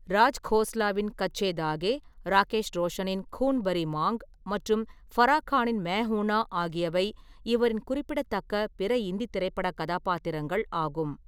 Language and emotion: Tamil, neutral